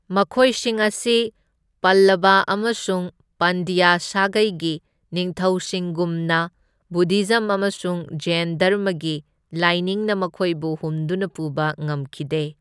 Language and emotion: Manipuri, neutral